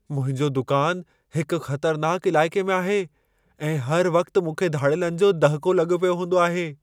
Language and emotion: Sindhi, fearful